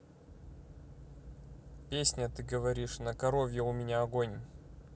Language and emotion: Russian, neutral